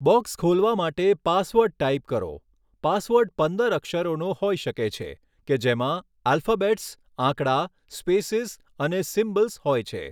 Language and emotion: Gujarati, neutral